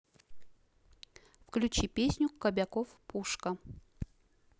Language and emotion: Russian, neutral